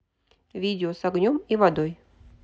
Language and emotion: Russian, neutral